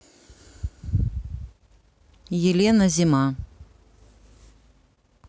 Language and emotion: Russian, neutral